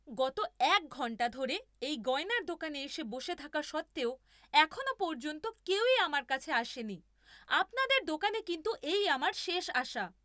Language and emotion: Bengali, angry